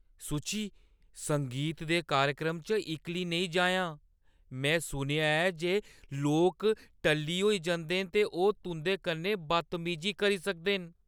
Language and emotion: Dogri, fearful